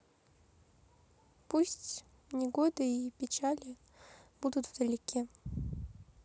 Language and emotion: Russian, sad